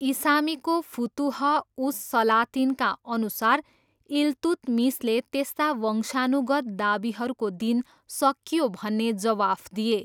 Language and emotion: Nepali, neutral